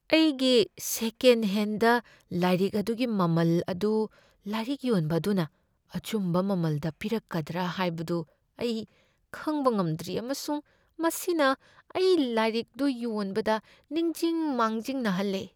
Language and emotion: Manipuri, fearful